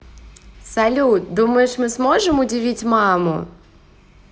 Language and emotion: Russian, positive